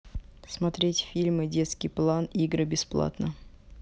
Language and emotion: Russian, neutral